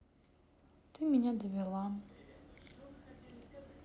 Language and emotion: Russian, sad